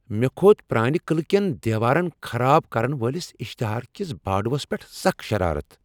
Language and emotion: Kashmiri, angry